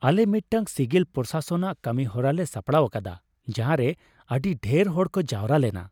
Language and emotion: Santali, happy